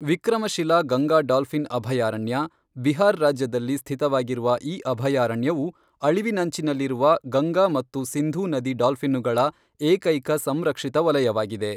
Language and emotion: Kannada, neutral